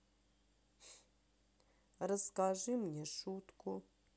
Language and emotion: Russian, sad